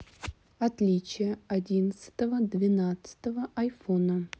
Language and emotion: Russian, neutral